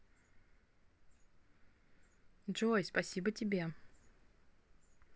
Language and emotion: Russian, positive